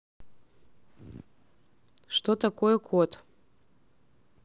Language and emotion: Russian, neutral